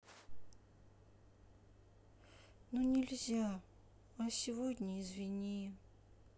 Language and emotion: Russian, sad